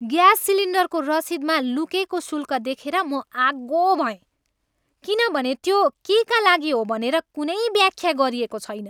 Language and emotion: Nepali, angry